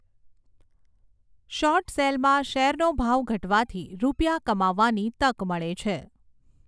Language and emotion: Gujarati, neutral